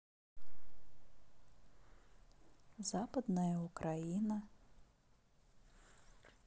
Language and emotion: Russian, neutral